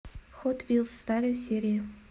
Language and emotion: Russian, neutral